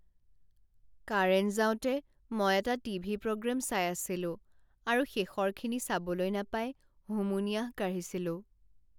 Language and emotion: Assamese, sad